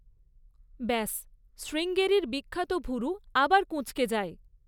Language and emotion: Bengali, neutral